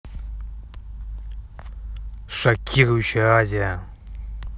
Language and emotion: Russian, angry